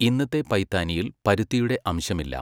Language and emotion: Malayalam, neutral